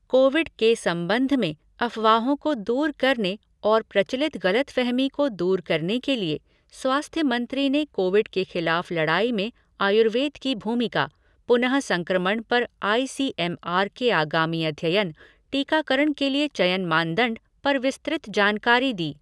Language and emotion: Hindi, neutral